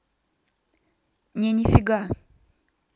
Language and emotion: Russian, neutral